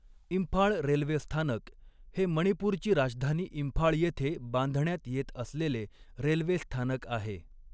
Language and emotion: Marathi, neutral